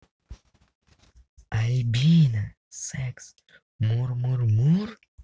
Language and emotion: Russian, positive